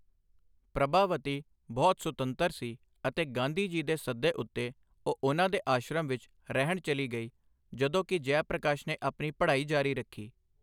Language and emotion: Punjabi, neutral